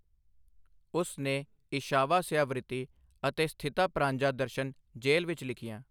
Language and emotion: Punjabi, neutral